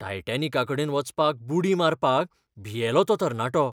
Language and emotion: Goan Konkani, fearful